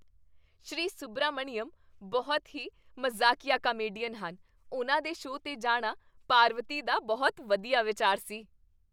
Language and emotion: Punjabi, happy